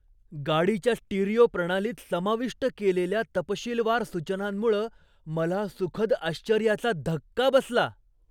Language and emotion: Marathi, surprised